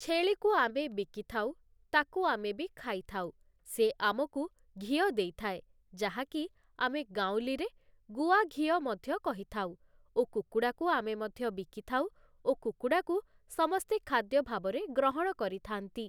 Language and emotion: Odia, neutral